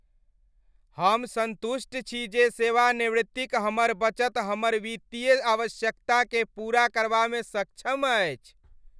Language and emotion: Maithili, happy